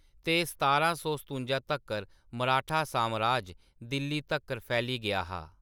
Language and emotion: Dogri, neutral